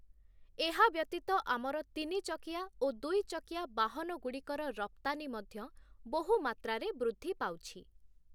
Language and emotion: Odia, neutral